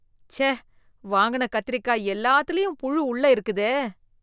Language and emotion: Tamil, disgusted